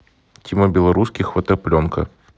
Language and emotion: Russian, neutral